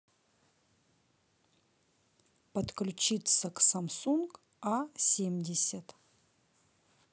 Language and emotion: Russian, neutral